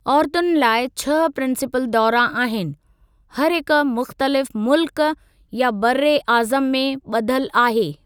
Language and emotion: Sindhi, neutral